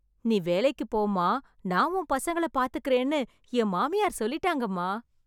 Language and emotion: Tamil, happy